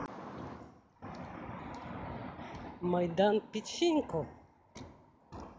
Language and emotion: Russian, positive